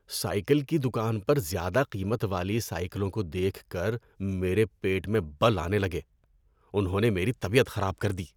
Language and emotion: Urdu, disgusted